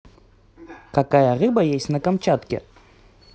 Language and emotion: Russian, positive